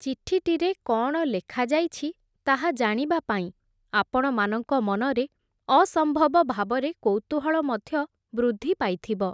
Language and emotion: Odia, neutral